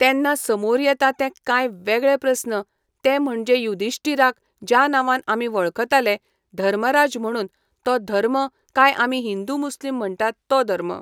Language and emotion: Goan Konkani, neutral